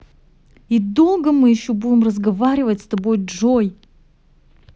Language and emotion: Russian, angry